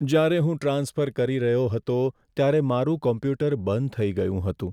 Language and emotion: Gujarati, sad